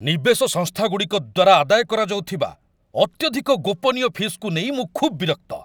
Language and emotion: Odia, angry